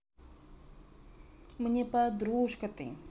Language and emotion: Russian, positive